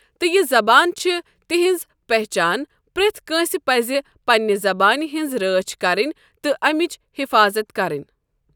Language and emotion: Kashmiri, neutral